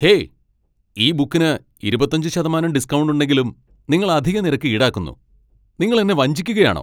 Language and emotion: Malayalam, angry